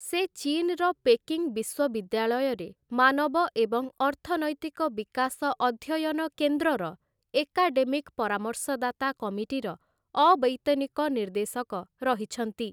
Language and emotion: Odia, neutral